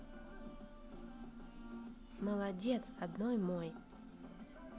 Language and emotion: Russian, positive